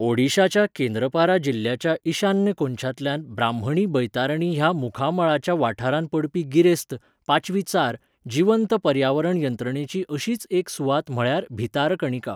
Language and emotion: Goan Konkani, neutral